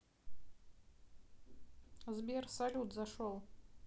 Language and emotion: Russian, neutral